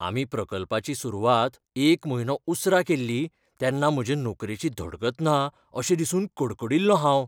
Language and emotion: Goan Konkani, fearful